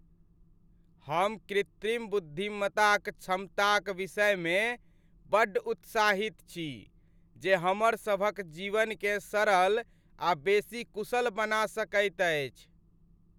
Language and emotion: Maithili, happy